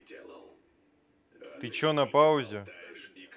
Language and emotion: Russian, neutral